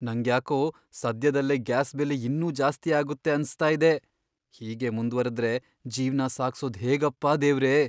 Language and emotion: Kannada, fearful